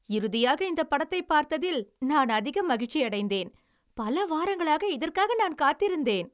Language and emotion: Tamil, happy